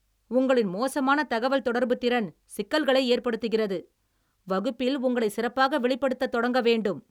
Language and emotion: Tamil, angry